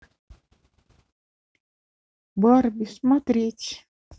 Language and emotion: Russian, neutral